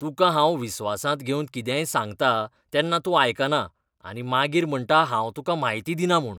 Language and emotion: Goan Konkani, disgusted